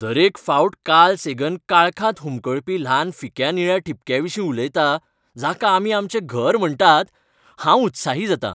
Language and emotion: Goan Konkani, happy